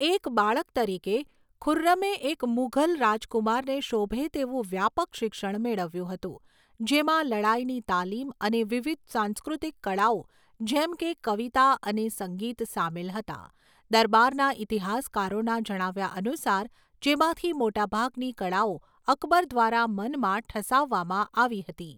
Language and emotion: Gujarati, neutral